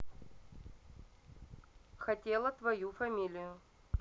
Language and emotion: Russian, neutral